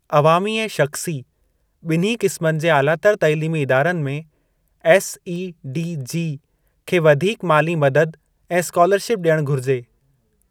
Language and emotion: Sindhi, neutral